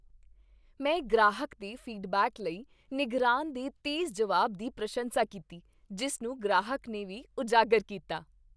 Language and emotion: Punjabi, happy